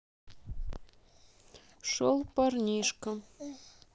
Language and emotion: Russian, sad